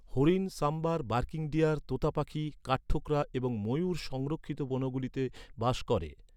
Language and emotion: Bengali, neutral